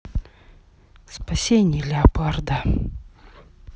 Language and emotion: Russian, sad